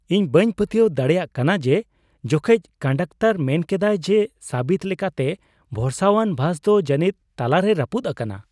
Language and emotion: Santali, surprised